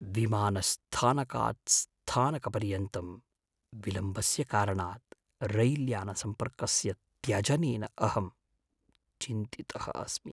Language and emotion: Sanskrit, fearful